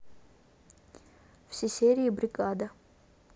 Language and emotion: Russian, neutral